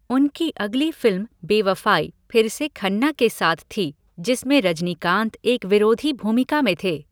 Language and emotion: Hindi, neutral